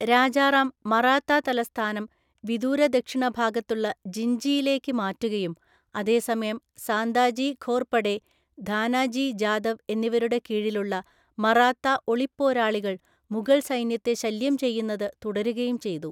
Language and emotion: Malayalam, neutral